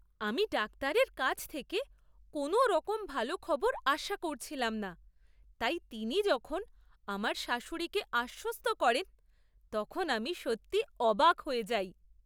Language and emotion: Bengali, surprised